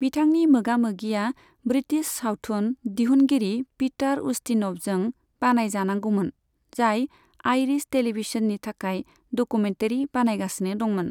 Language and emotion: Bodo, neutral